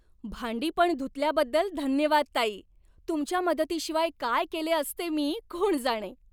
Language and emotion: Marathi, happy